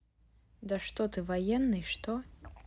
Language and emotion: Russian, neutral